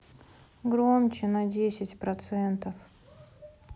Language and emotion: Russian, sad